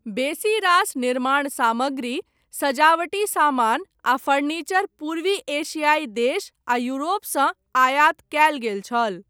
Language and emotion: Maithili, neutral